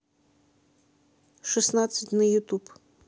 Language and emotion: Russian, neutral